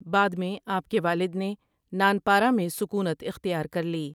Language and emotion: Urdu, neutral